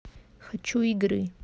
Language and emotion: Russian, neutral